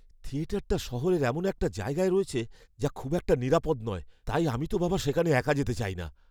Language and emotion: Bengali, fearful